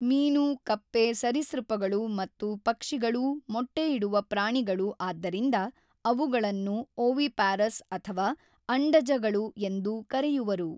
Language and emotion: Kannada, neutral